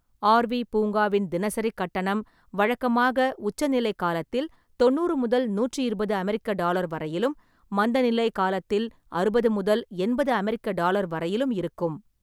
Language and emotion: Tamil, neutral